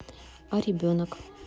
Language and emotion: Russian, neutral